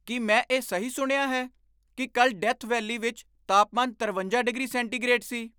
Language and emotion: Punjabi, surprised